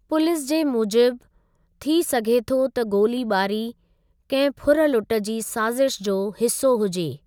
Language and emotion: Sindhi, neutral